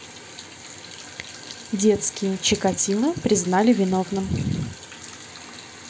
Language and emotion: Russian, neutral